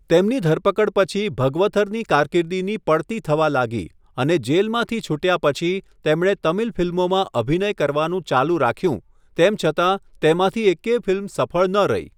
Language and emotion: Gujarati, neutral